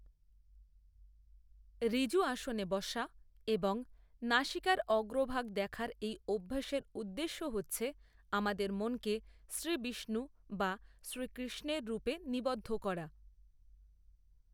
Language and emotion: Bengali, neutral